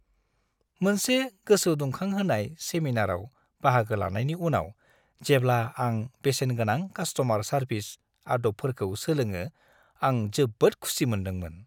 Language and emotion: Bodo, happy